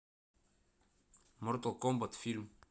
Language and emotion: Russian, neutral